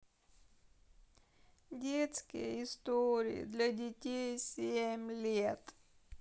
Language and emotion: Russian, sad